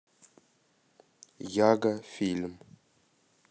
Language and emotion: Russian, neutral